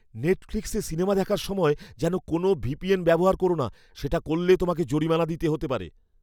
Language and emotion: Bengali, fearful